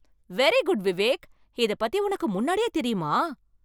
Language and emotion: Tamil, surprised